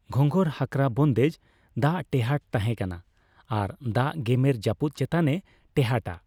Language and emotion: Santali, neutral